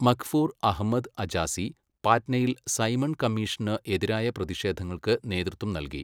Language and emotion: Malayalam, neutral